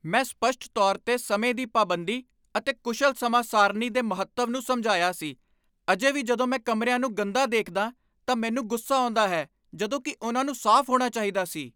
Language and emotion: Punjabi, angry